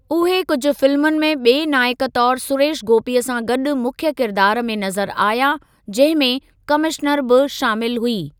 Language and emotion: Sindhi, neutral